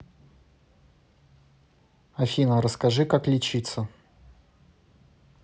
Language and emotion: Russian, neutral